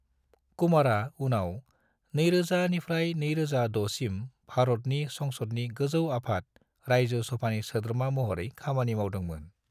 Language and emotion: Bodo, neutral